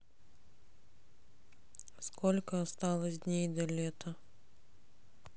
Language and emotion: Russian, sad